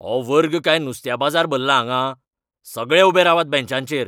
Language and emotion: Goan Konkani, angry